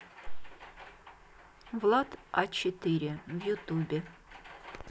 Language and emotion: Russian, neutral